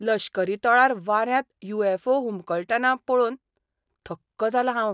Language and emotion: Goan Konkani, surprised